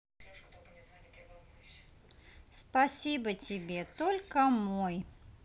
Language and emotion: Russian, positive